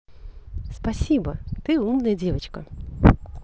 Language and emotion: Russian, positive